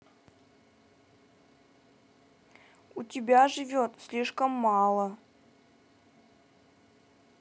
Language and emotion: Russian, sad